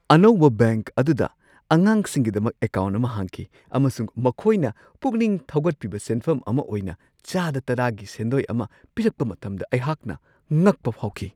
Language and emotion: Manipuri, surprised